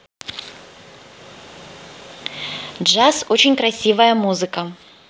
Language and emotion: Russian, positive